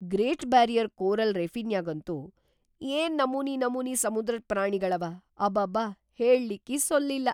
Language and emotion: Kannada, surprised